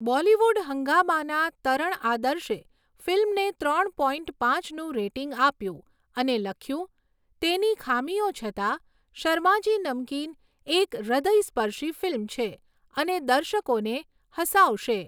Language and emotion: Gujarati, neutral